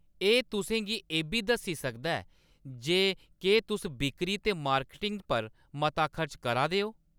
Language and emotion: Dogri, neutral